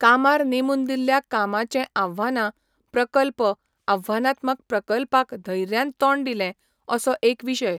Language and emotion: Goan Konkani, neutral